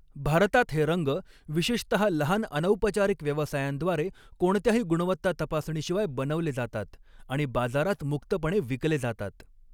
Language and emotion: Marathi, neutral